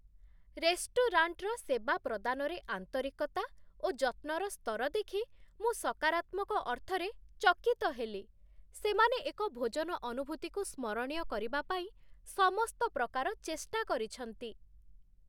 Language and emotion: Odia, surprised